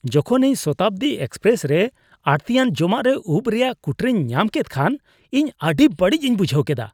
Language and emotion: Santali, disgusted